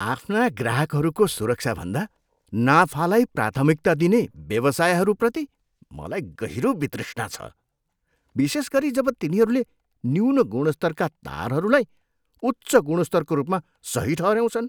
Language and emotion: Nepali, disgusted